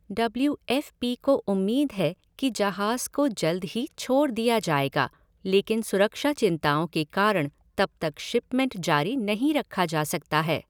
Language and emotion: Hindi, neutral